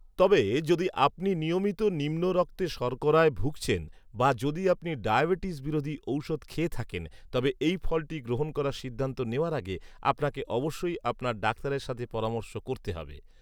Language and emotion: Bengali, neutral